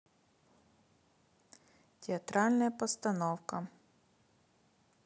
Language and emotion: Russian, neutral